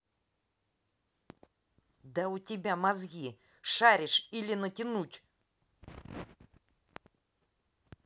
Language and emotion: Russian, angry